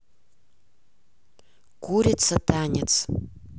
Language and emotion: Russian, neutral